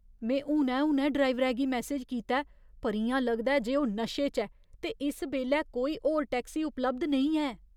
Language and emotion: Dogri, fearful